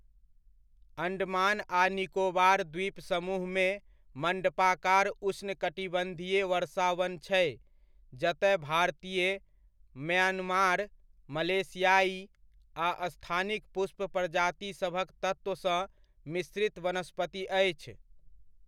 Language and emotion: Maithili, neutral